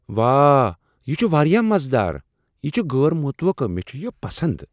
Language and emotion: Kashmiri, surprised